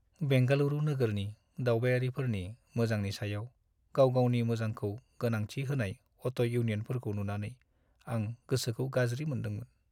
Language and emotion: Bodo, sad